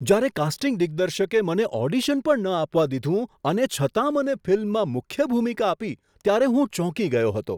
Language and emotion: Gujarati, surprised